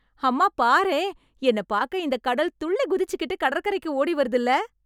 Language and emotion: Tamil, happy